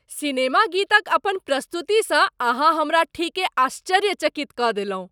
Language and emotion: Maithili, surprised